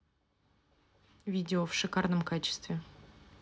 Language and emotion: Russian, neutral